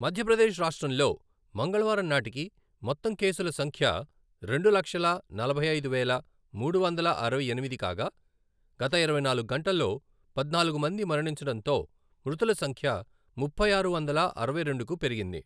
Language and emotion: Telugu, neutral